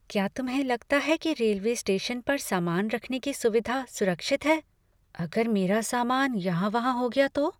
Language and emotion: Hindi, fearful